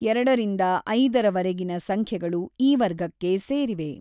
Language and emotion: Kannada, neutral